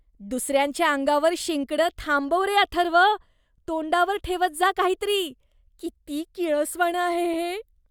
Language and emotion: Marathi, disgusted